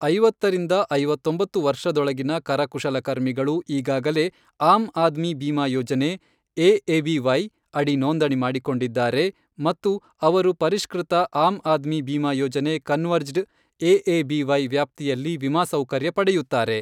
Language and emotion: Kannada, neutral